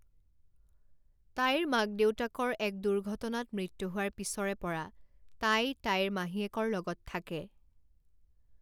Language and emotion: Assamese, neutral